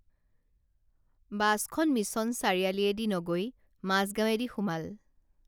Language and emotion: Assamese, neutral